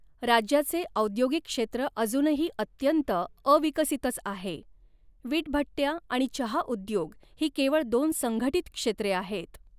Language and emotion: Marathi, neutral